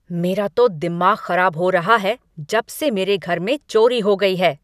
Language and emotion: Hindi, angry